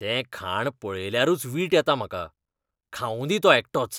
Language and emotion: Goan Konkani, disgusted